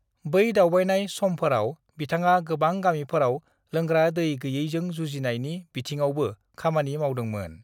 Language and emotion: Bodo, neutral